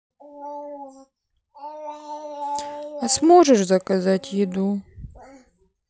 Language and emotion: Russian, sad